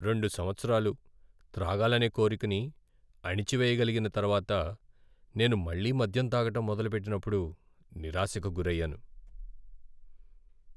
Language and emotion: Telugu, sad